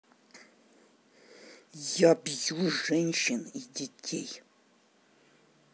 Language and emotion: Russian, angry